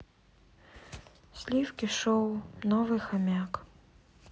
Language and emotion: Russian, sad